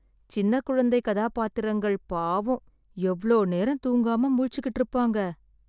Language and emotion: Tamil, sad